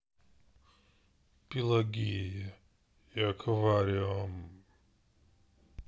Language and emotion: Russian, sad